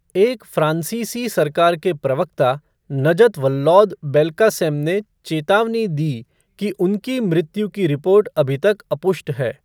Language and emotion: Hindi, neutral